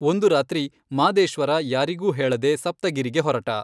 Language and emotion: Kannada, neutral